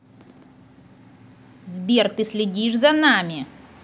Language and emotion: Russian, angry